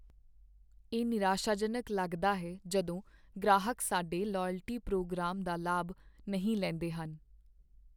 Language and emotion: Punjabi, sad